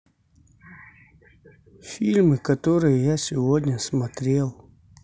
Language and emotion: Russian, sad